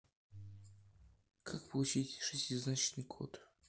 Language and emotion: Russian, neutral